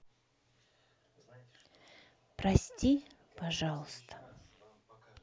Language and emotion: Russian, sad